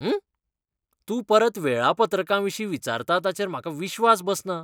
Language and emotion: Goan Konkani, disgusted